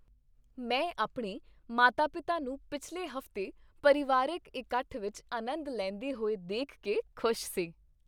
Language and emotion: Punjabi, happy